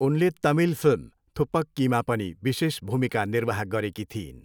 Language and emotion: Nepali, neutral